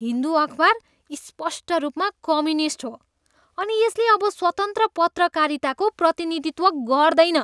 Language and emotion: Nepali, disgusted